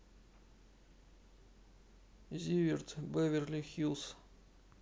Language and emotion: Russian, sad